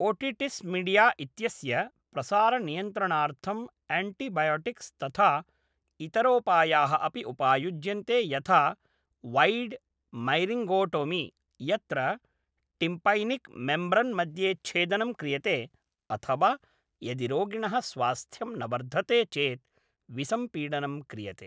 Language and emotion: Sanskrit, neutral